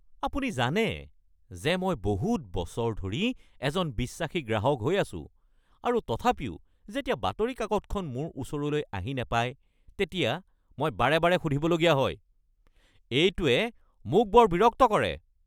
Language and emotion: Assamese, angry